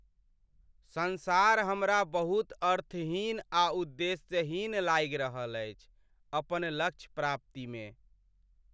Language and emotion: Maithili, sad